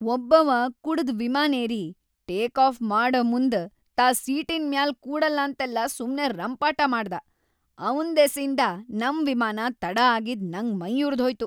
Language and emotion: Kannada, angry